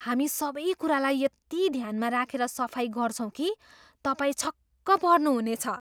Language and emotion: Nepali, surprised